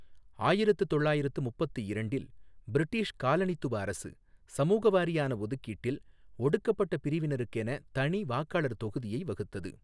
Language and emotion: Tamil, neutral